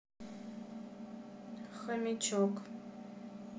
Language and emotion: Russian, sad